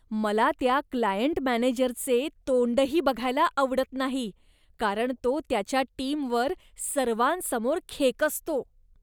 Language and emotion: Marathi, disgusted